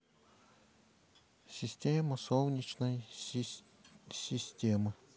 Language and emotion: Russian, neutral